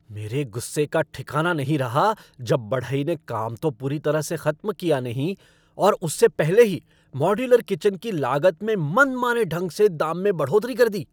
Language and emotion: Hindi, angry